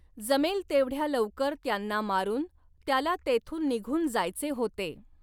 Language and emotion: Marathi, neutral